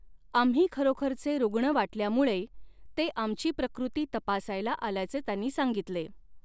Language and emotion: Marathi, neutral